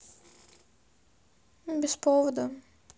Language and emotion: Russian, sad